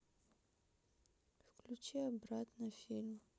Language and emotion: Russian, sad